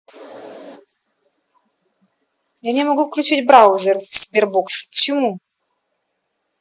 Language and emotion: Russian, angry